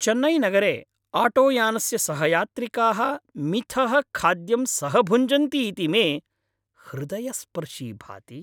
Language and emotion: Sanskrit, happy